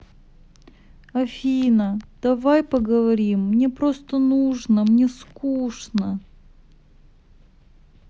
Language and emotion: Russian, sad